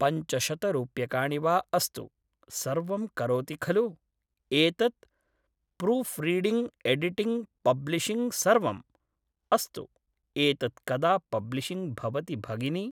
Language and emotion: Sanskrit, neutral